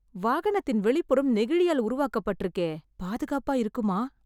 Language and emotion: Tamil, fearful